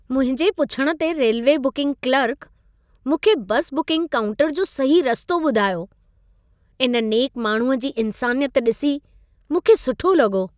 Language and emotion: Sindhi, happy